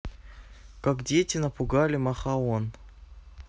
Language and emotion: Russian, neutral